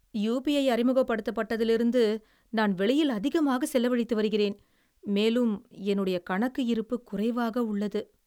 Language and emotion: Tamil, sad